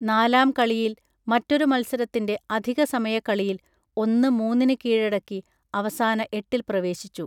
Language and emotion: Malayalam, neutral